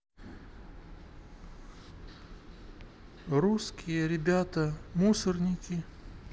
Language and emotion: Russian, sad